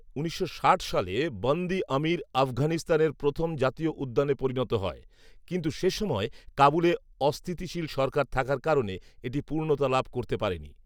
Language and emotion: Bengali, neutral